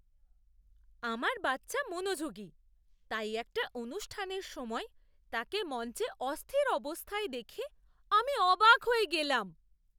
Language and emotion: Bengali, surprised